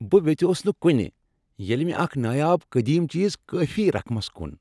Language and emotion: Kashmiri, happy